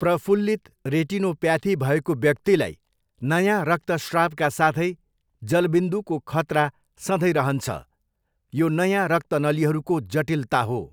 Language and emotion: Nepali, neutral